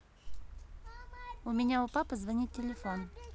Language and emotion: Russian, neutral